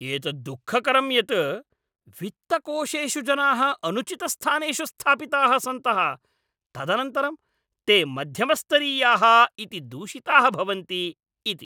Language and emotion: Sanskrit, angry